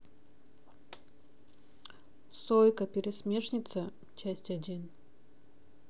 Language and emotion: Russian, neutral